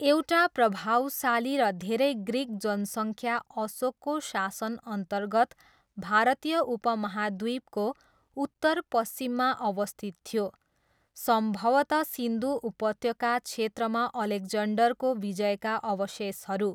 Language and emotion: Nepali, neutral